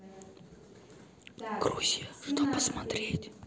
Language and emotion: Russian, neutral